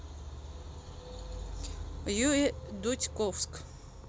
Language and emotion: Russian, neutral